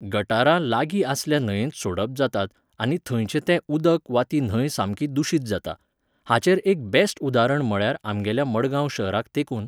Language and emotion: Goan Konkani, neutral